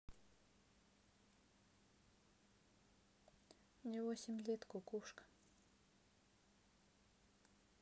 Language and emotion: Russian, neutral